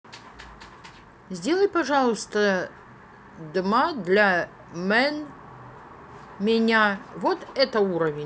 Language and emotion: Russian, neutral